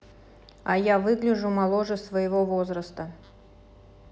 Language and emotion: Russian, neutral